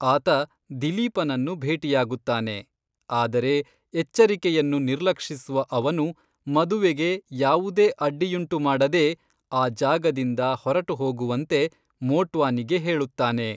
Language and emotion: Kannada, neutral